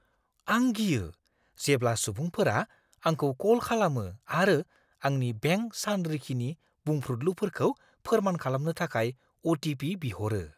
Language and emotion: Bodo, fearful